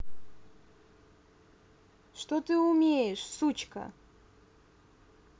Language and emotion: Russian, angry